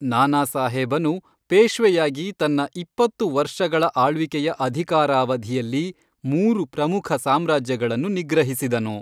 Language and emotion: Kannada, neutral